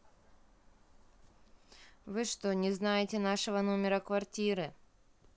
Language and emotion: Russian, neutral